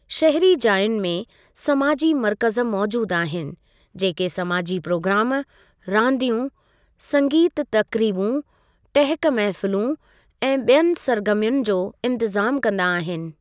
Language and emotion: Sindhi, neutral